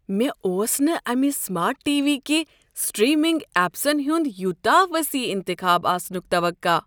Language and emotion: Kashmiri, surprised